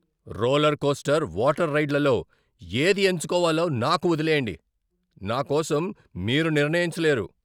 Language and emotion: Telugu, angry